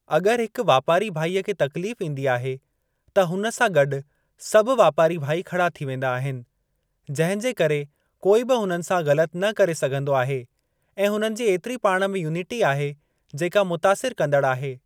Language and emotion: Sindhi, neutral